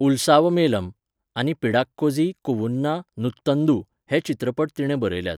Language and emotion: Goan Konkani, neutral